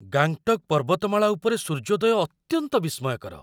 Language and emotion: Odia, surprised